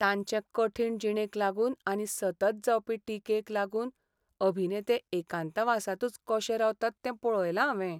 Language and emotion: Goan Konkani, sad